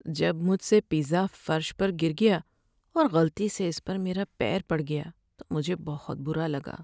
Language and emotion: Urdu, sad